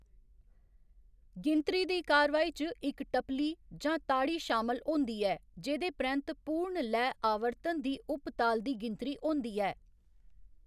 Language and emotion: Dogri, neutral